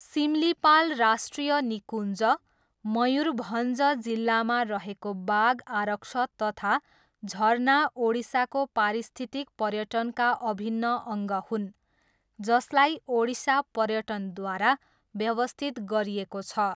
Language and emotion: Nepali, neutral